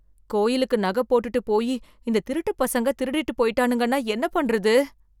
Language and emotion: Tamil, fearful